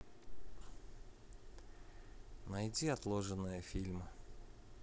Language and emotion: Russian, neutral